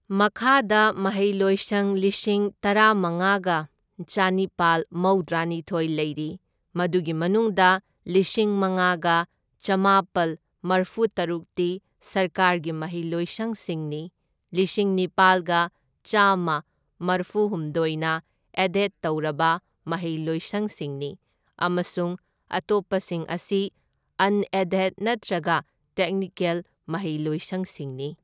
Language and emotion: Manipuri, neutral